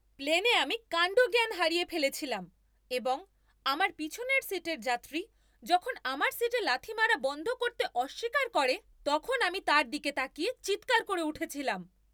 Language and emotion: Bengali, angry